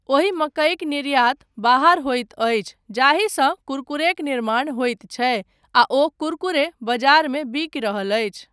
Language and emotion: Maithili, neutral